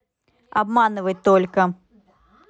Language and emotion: Russian, angry